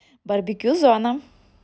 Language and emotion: Russian, neutral